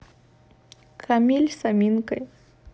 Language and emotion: Russian, neutral